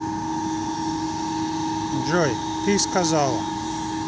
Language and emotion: Russian, neutral